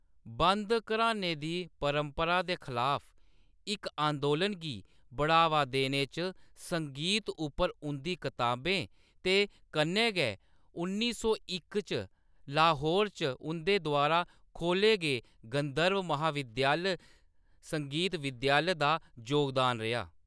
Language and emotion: Dogri, neutral